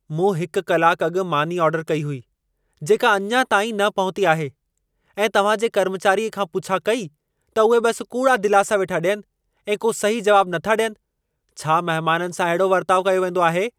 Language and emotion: Sindhi, angry